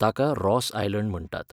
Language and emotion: Goan Konkani, neutral